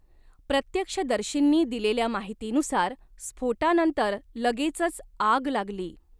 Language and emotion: Marathi, neutral